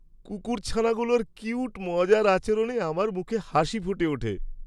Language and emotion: Bengali, happy